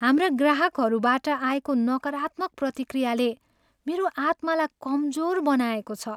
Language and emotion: Nepali, sad